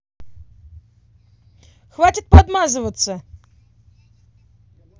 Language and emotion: Russian, angry